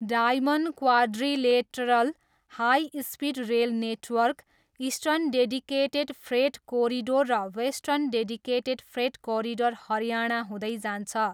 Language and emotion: Nepali, neutral